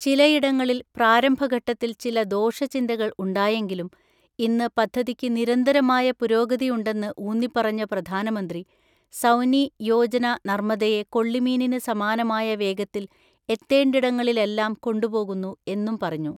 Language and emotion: Malayalam, neutral